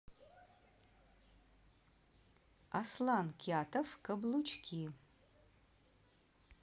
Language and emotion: Russian, neutral